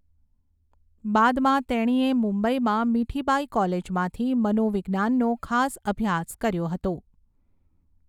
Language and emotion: Gujarati, neutral